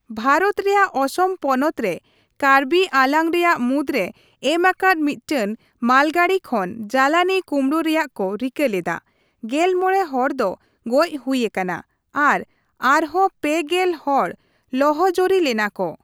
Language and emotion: Santali, neutral